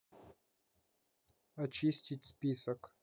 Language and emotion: Russian, neutral